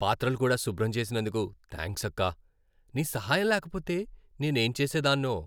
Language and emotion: Telugu, happy